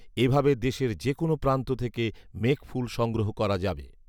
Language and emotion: Bengali, neutral